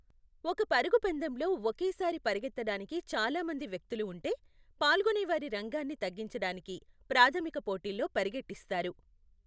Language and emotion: Telugu, neutral